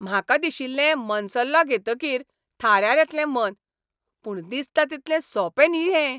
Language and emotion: Goan Konkani, angry